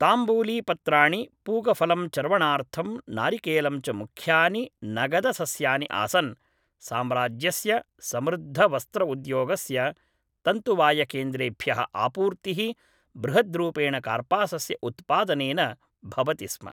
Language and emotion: Sanskrit, neutral